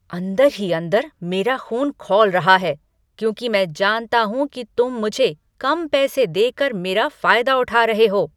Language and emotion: Hindi, angry